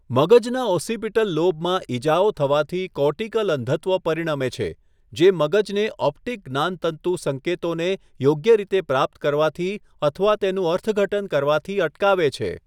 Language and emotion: Gujarati, neutral